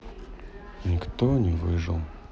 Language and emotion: Russian, sad